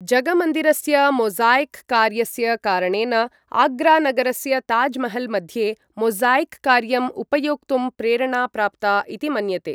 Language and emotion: Sanskrit, neutral